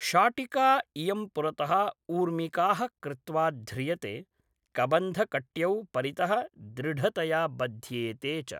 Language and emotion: Sanskrit, neutral